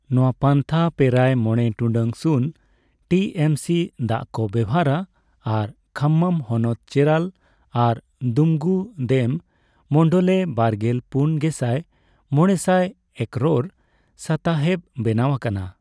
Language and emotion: Santali, neutral